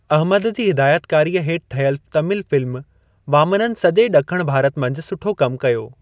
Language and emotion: Sindhi, neutral